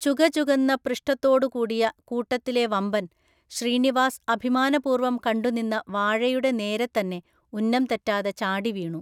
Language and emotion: Malayalam, neutral